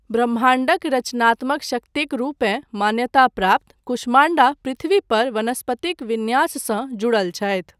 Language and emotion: Maithili, neutral